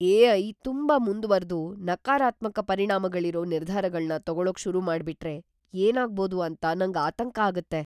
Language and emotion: Kannada, fearful